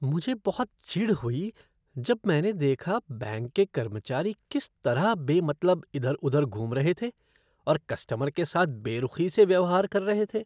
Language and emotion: Hindi, disgusted